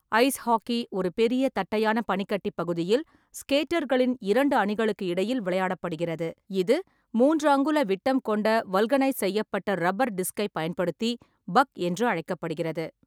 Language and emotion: Tamil, neutral